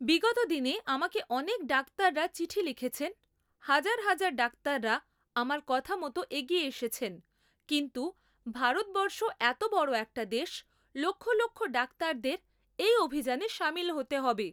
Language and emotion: Bengali, neutral